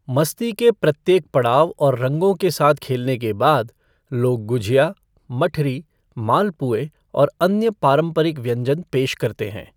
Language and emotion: Hindi, neutral